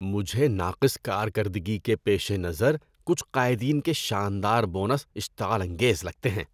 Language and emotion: Urdu, disgusted